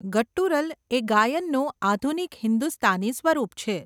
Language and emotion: Gujarati, neutral